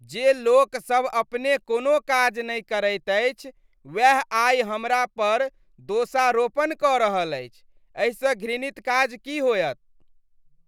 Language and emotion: Maithili, disgusted